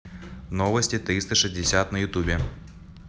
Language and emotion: Russian, neutral